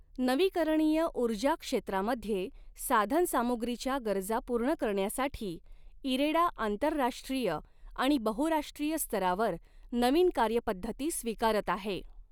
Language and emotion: Marathi, neutral